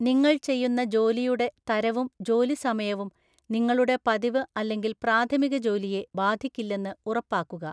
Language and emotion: Malayalam, neutral